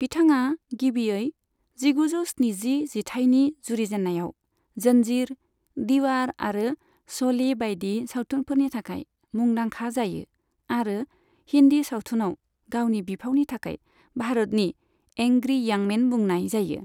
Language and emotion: Bodo, neutral